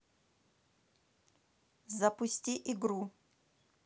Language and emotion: Russian, neutral